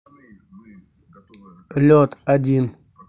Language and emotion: Russian, neutral